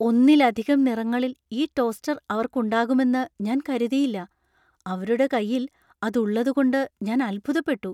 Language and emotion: Malayalam, surprised